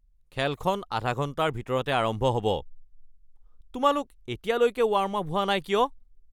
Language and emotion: Assamese, angry